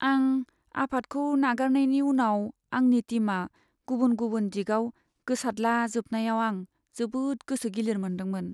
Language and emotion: Bodo, sad